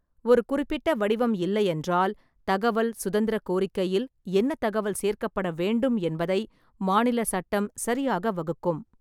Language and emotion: Tamil, neutral